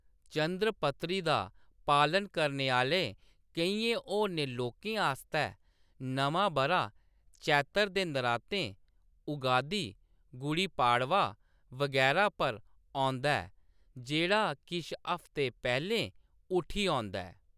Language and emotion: Dogri, neutral